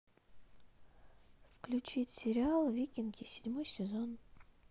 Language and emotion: Russian, neutral